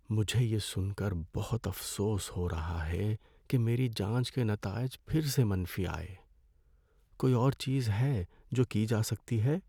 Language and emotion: Urdu, sad